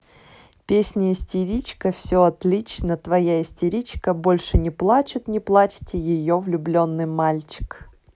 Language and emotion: Russian, neutral